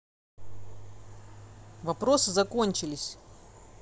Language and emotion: Russian, neutral